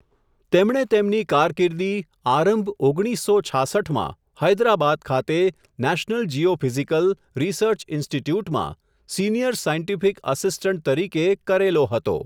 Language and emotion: Gujarati, neutral